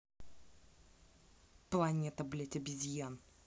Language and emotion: Russian, angry